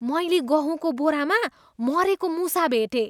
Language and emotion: Nepali, disgusted